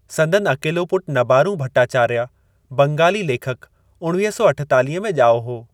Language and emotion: Sindhi, neutral